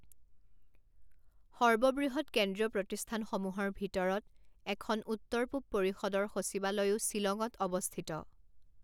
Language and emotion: Assamese, neutral